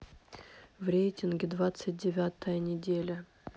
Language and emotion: Russian, sad